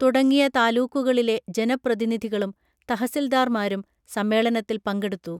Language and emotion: Malayalam, neutral